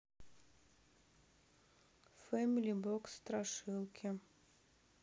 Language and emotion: Russian, neutral